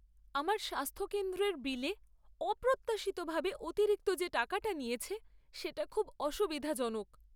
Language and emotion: Bengali, sad